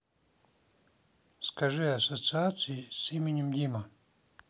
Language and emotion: Russian, neutral